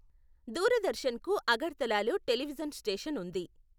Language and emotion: Telugu, neutral